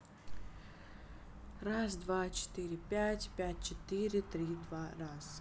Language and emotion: Russian, neutral